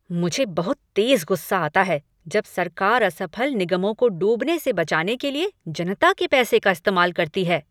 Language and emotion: Hindi, angry